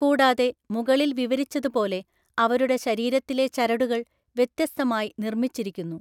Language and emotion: Malayalam, neutral